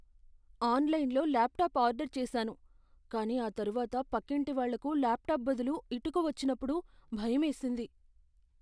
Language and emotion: Telugu, fearful